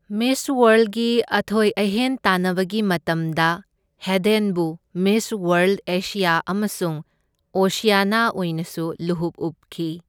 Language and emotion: Manipuri, neutral